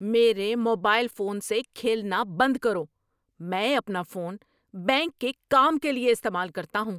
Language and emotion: Urdu, angry